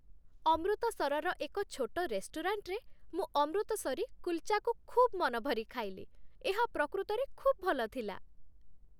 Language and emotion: Odia, happy